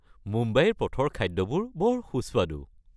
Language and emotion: Assamese, happy